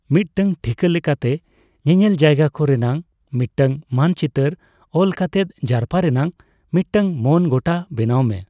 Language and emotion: Santali, neutral